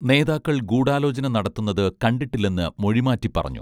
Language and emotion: Malayalam, neutral